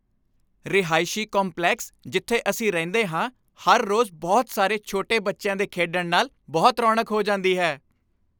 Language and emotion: Punjabi, happy